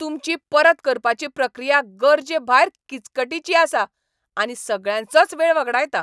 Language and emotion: Goan Konkani, angry